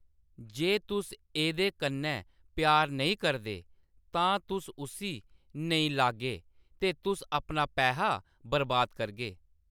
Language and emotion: Dogri, neutral